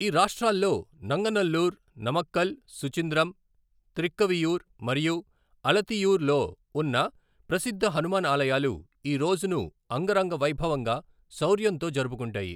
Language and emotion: Telugu, neutral